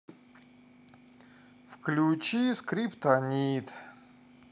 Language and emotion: Russian, sad